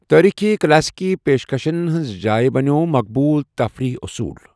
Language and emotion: Kashmiri, neutral